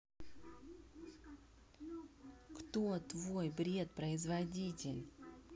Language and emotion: Russian, angry